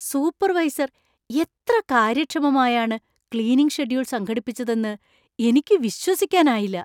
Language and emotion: Malayalam, surprised